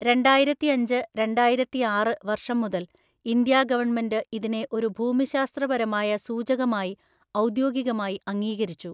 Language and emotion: Malayalam, neutral